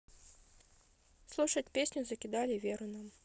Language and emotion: Russian, neutral